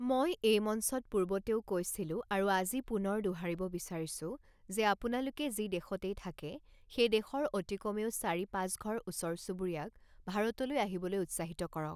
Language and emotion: Assamese, neutral